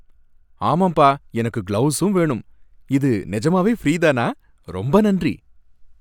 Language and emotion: Tamil, happy